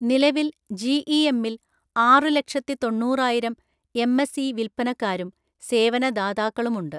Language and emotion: Malayalam, neutral